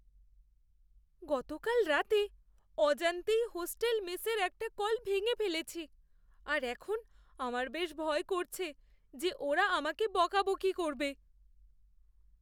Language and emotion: Bengali, fearful